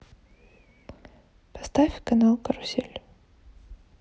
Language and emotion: Russian, sad